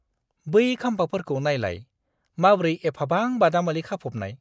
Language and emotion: Bodo, disgusted